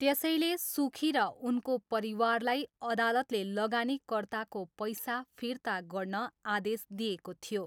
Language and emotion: Nepali, neutral